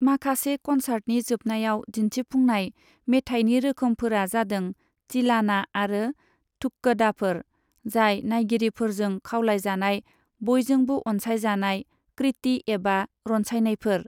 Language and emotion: Bodo, neutral